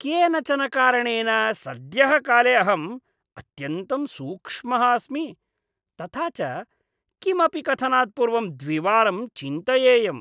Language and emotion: Sanskrit, disgusted